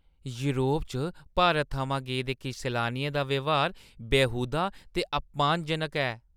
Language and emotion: Dogri, disgusted